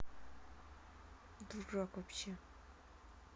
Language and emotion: Russian, angry